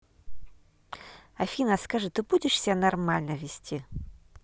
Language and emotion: Russian, angry